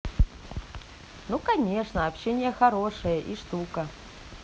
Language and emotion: Russian, positive